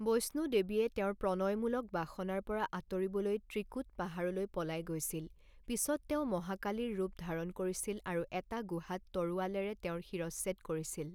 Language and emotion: Assamese, neutral